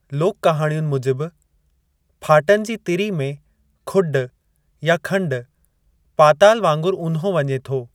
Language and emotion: Sindhi, neutral